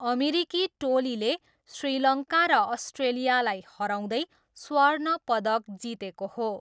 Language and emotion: Nepali, neutral